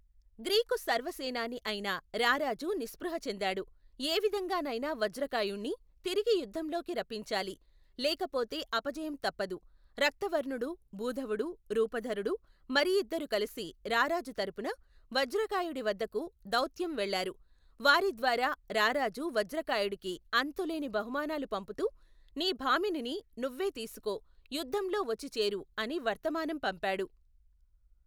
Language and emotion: Telugu, neutral